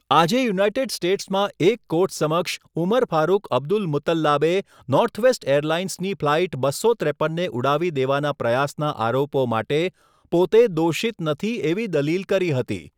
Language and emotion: Gujarati, neutral